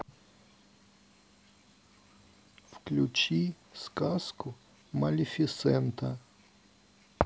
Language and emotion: Russian, sad